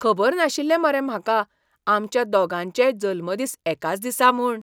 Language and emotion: Goan Konkani, surprised